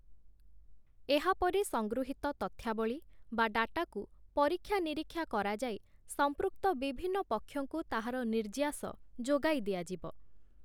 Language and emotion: Odia, neutral